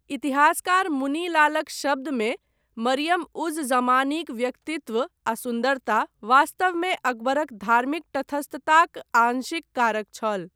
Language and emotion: Maithili, neutral